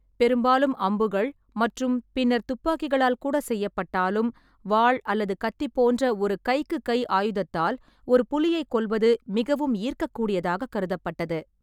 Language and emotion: Tamil, neutral